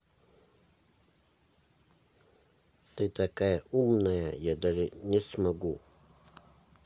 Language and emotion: Russian, neutral